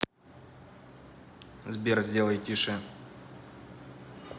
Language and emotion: Russian, neutral